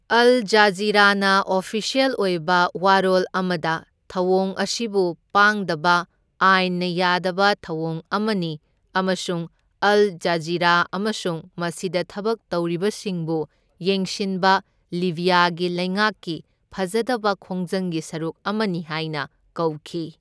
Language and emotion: Manipuri, neutral